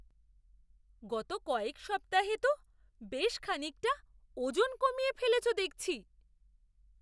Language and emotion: Bengali, surprised